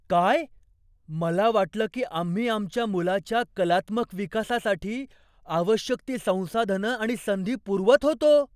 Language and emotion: Marathi, surprised